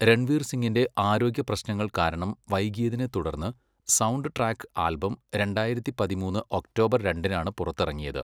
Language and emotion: Malayalam, neutral